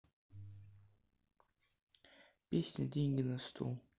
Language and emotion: Russian, sad